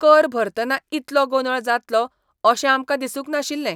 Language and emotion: Goan Konkani, disgusted